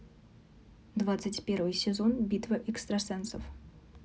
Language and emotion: Russian, neutral